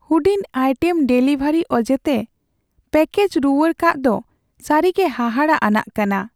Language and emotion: Santali, sad